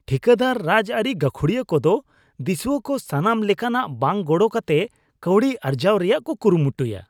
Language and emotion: Santali, disgusted